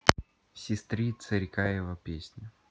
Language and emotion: Russian, neutral